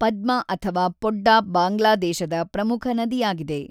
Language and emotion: Kannada, neutral